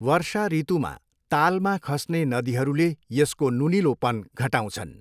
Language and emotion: Nepali, neutral